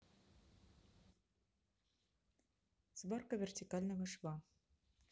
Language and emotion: Russian, neutral